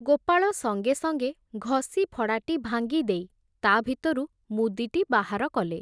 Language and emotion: Odia, neutral